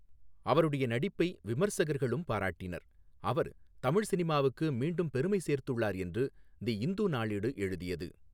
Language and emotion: Tamil, neutral